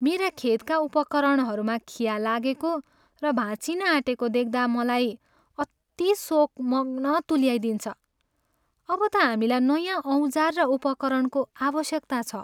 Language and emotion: Nepali, sad